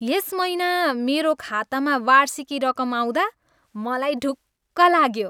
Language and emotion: Nepali, happy